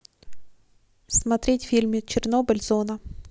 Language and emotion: Russian, neutral